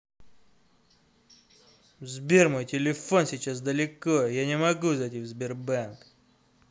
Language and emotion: Russian, angry